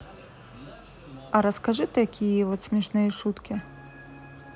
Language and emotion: Russian, neutral